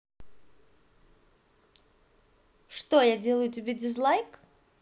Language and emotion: Russian, positive